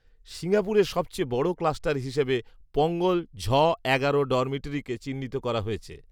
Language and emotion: Bengali, neutral